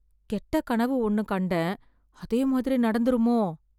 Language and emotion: Tamil, fearful